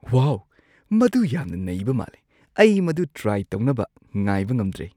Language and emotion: Manipuri, surprised